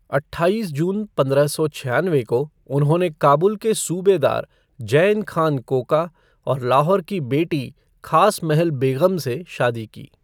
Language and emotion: Hindi, neutral